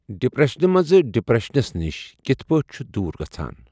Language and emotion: Kashmiri, neutral